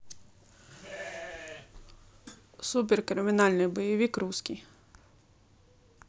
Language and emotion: Russian, neutral